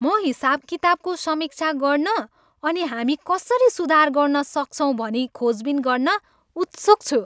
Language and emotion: Nepali, happy